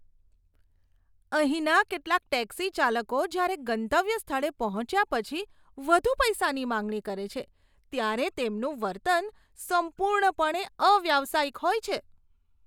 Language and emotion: Gujarati, disgusted